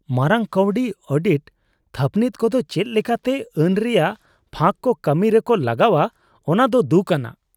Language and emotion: Santali, disgusted